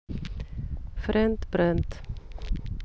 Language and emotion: Russian, neutral